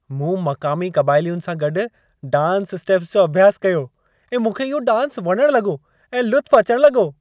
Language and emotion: Sindhi, happy